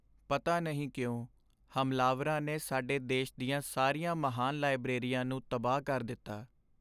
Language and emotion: Punjabi, sad